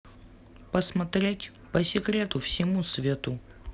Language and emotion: Russian, neutral